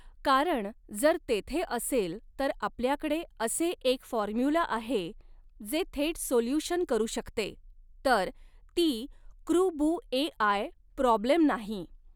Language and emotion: Marathi, neutral